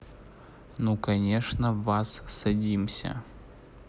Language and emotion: Russian, neutral